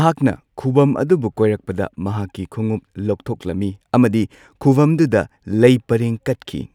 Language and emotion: Manipuri, neutral